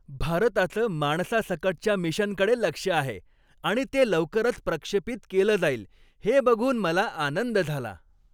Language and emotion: Marathi, happy